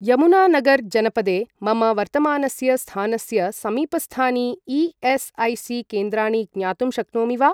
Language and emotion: Sanskrit, neutral